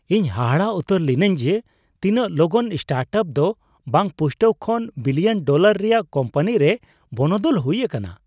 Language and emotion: Santali, surprised